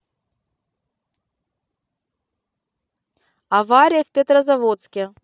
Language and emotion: Russian, neutral